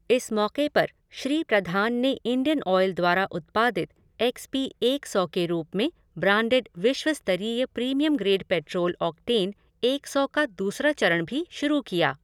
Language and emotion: Hindi, neutral